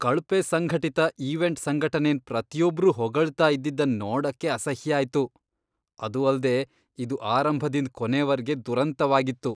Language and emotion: Kannada, disgusted